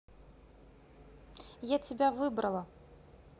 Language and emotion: Russian, neutral